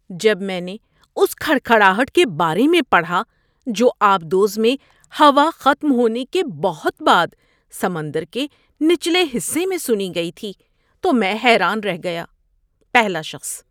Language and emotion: Urdu, surprised